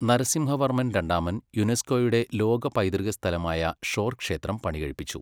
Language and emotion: Malayalam, neutral